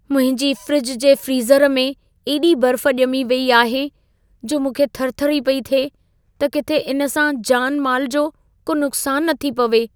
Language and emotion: Sindhi, fearful